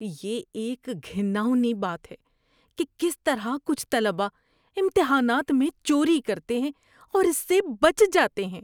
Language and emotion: Urdu, disgusted